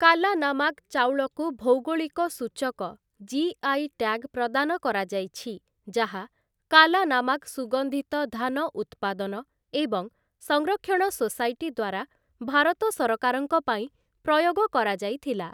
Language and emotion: Odia, neutral